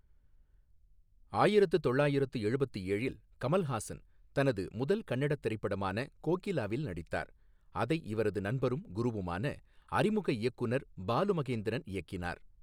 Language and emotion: Tamil, neutral